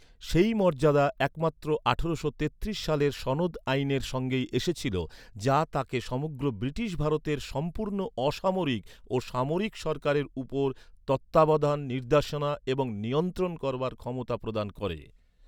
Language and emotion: Bengali, neutral